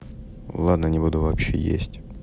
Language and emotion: Russian, neutral